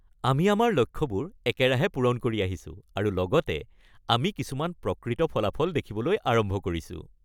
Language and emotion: Assamese, happy